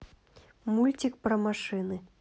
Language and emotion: Russian, neutral